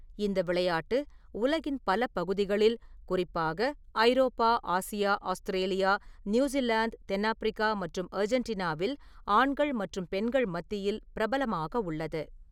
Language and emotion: Tamil, neutral